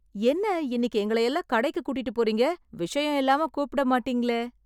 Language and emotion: Tamil, surprised